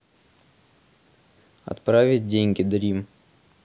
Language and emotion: Russian, neutral